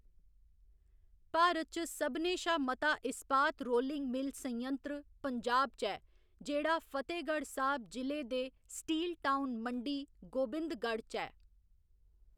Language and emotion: Dogri, neutral